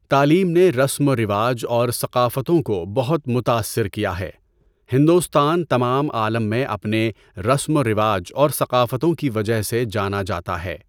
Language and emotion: Urdu, neutral